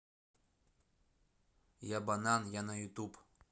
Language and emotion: Russian, neutral